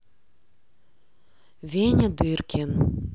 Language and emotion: Russian, neutral